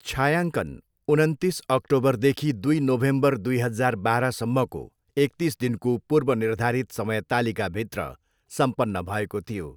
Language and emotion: Nepali, neutral